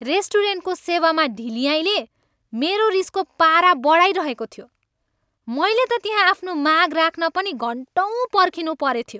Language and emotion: Nepali, angry